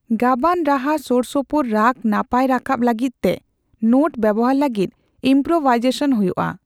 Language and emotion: Santali, neutral